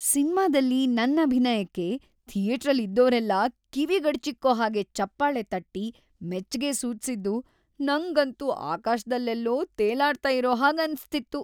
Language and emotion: Kannada, happy